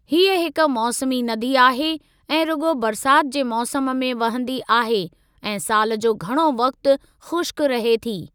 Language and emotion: Sindhi, neutral